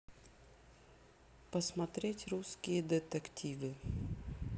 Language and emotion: Russian, neutral